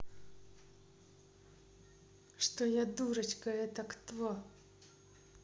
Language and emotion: Russian, neutral